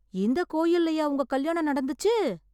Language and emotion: Tamil, surprised